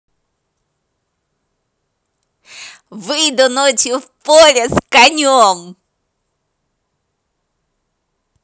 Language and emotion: Russian, positive